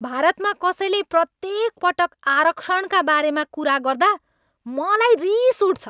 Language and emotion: Nepali, angry